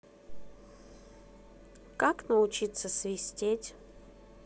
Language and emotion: Russian, neutral